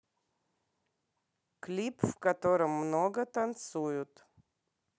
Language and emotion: Russian, neutral